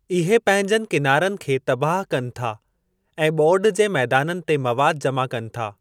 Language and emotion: Sindhi, neutral